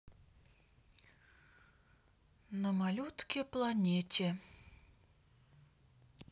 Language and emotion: Russian, neutral